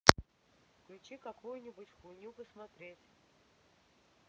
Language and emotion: Russian, neutral